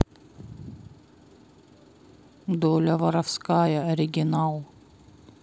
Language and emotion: Russian, neutral